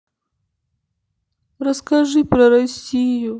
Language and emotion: Russian, sad